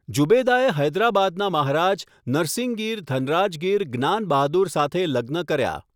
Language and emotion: Gujarati, neutral